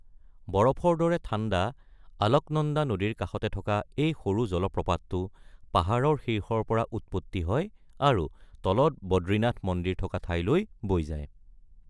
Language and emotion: Assamese, neutral